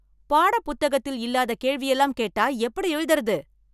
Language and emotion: Tamil, angry